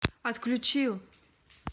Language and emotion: Russian, neutral